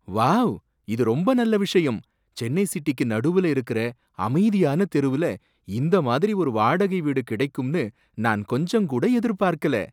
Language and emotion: Tamil, surprised